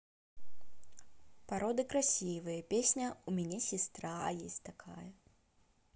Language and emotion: Russian, positive